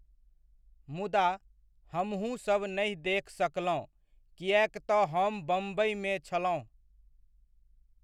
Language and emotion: Maithili, neutral